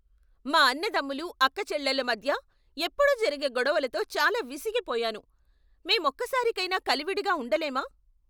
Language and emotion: Telugu, angry